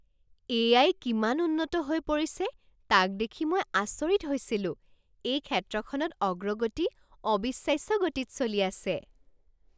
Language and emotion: Assamese, surprised